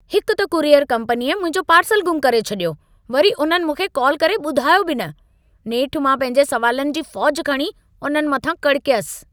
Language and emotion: Sindhi, angry